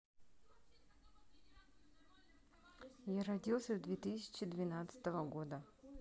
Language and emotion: Russian, neutral